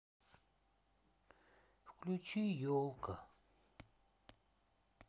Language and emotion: Russian, sad